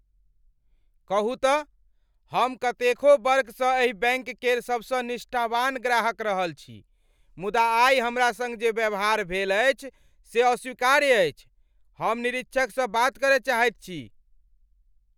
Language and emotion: Maithili, angry